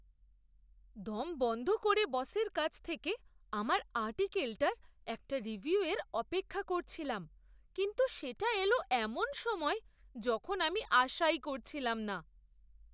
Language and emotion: Bengali, surprised